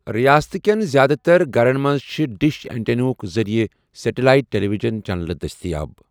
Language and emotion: Kashmiri, neutral